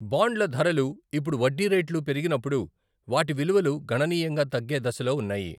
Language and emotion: Telugu, neutral